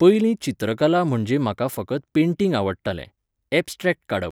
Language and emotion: Goan Konkani, neutral